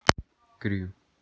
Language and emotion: Russian, neutral